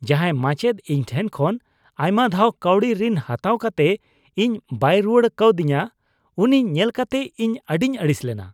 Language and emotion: Santali, disgusted